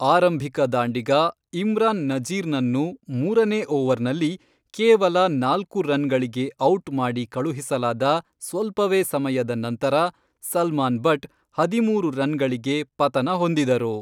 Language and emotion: Kannada, neutral